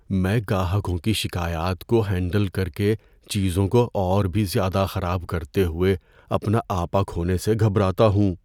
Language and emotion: Urdu, fearful